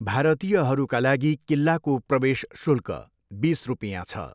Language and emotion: Nepali, neutral